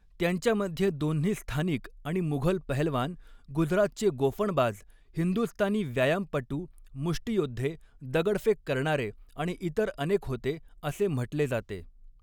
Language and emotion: Marathi, neutral